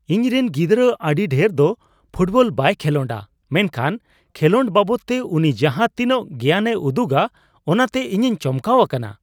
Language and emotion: Santali, surprised